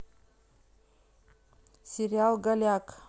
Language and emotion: Russian, neutral